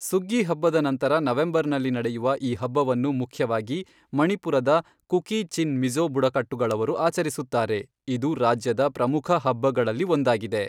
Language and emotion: Kannada, neutral